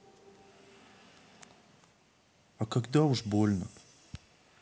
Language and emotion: Russian, sad